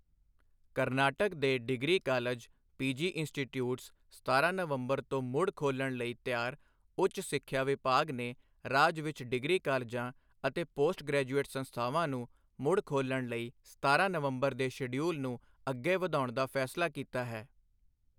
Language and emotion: Punjabi, neutral